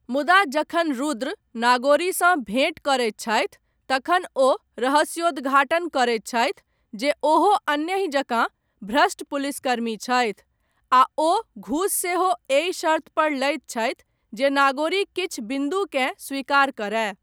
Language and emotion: Maithili, neutral